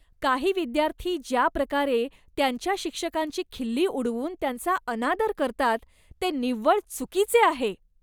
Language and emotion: Marathi, disgusted